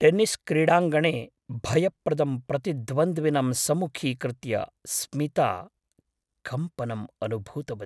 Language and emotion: Sanskrit, fearful